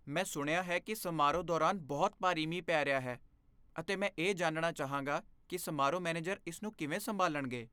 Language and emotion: Punjabi, fearful